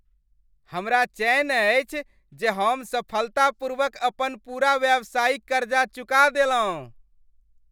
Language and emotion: Maithili, happy